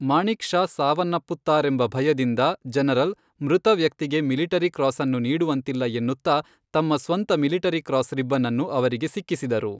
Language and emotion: Kannada, neutral